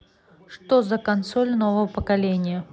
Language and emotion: Russian, neutral